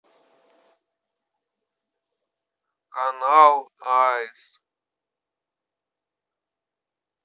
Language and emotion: Russian, neutral